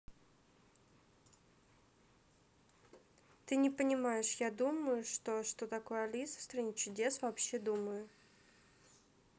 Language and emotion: Russian, neutral